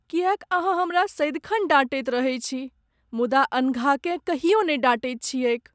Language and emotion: Maithili, sad